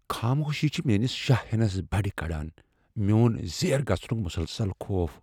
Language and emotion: Kashmiri, fearful